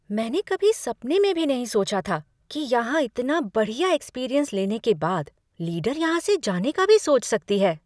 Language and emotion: Hindi, surprised